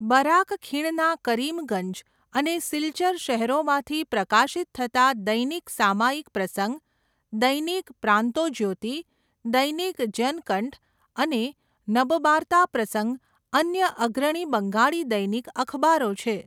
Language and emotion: Gujarati, neutral